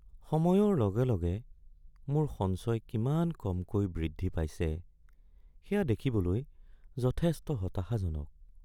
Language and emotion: Assamese, sad